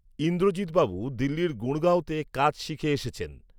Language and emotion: Bengali, neutral